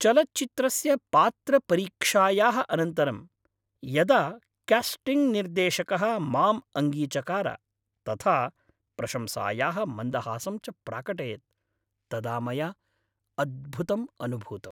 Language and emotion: Sanskrit, happy